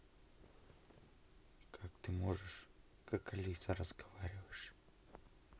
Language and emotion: Russian, neutral